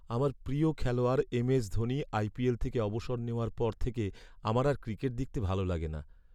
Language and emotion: Bengali, sad